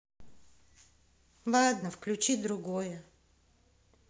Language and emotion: Russian, sad